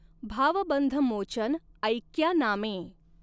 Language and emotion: Marathi, neutral